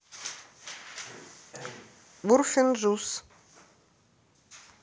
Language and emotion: Russian, neutral